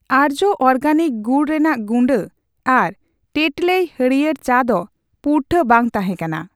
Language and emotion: Santali, neutral